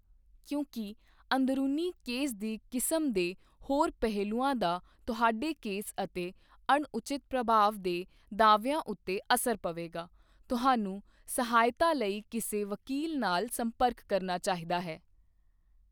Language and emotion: Punjabi, neutral